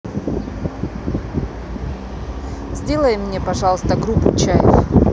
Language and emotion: Russian, neutral